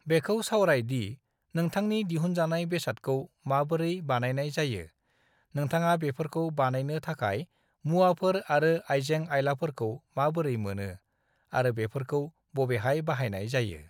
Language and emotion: Bodo, neutral